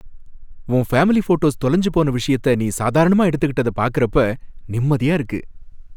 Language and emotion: Tamil, happy